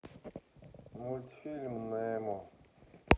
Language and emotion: Russian, sad